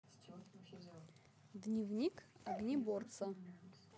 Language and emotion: Russian, neutral